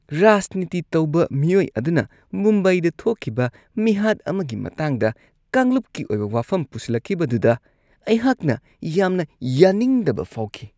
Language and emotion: Manipuri, disgusted